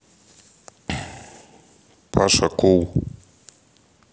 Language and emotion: Russian, neutral